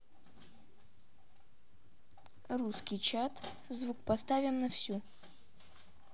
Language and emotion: Russian, neutral